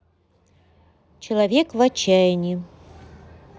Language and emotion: Russian, neutral